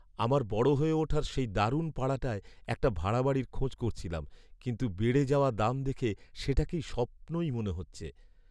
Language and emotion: Bengali, sad